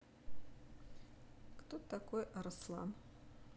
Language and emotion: Russian, neutral